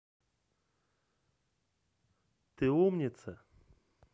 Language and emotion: Russian, positive